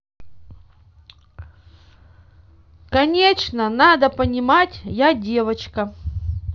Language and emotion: Russian, neutral